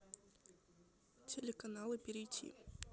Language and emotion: Russian, neutral